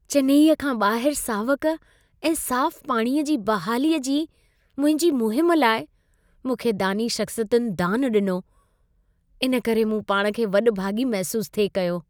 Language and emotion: Sindhi, happy